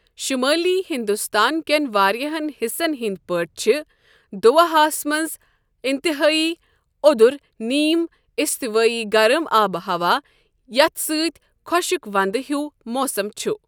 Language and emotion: Kashmiri, neutral